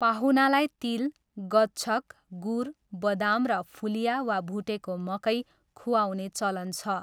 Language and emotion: Nepali, neutral